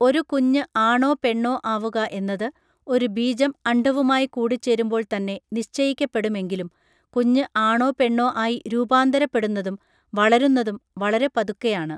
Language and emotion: Malayalam, neutral